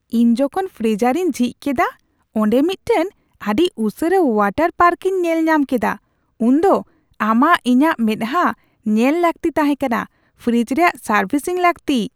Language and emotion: Santali, surprised